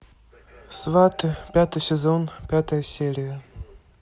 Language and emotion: Russian, neutral